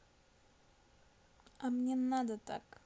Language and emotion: Russian, neutral